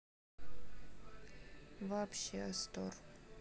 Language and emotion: Russian, sad